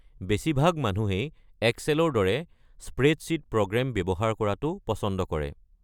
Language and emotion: Assamese, neutral